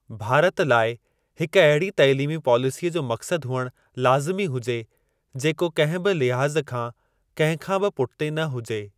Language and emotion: Sindhi, neutral